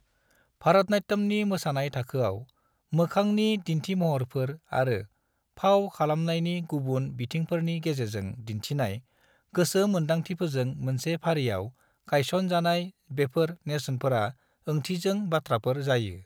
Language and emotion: Bodo, neutral